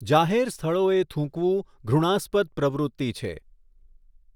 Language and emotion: Gujarati, neutral